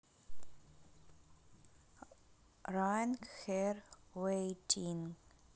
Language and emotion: Russian, neutral